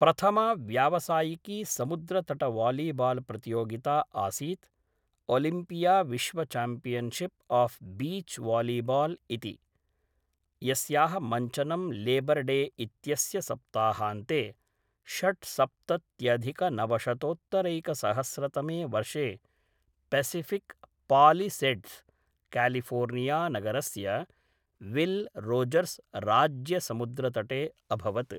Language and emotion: Sanskrit, neutral